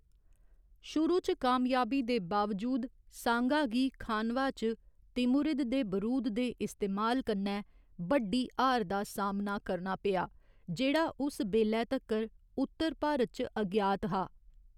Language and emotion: Dogri, neutral